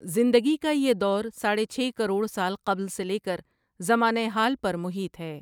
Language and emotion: Urdu, neutral